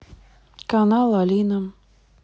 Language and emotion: Russian, neutral